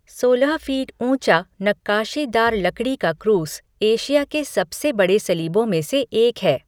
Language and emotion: Hindi, neutral